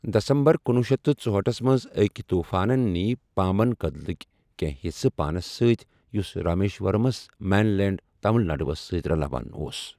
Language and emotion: Kashmiri, neutral